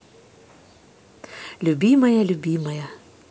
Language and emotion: Russian, positive